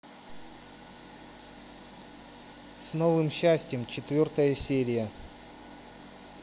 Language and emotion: Russian, neutral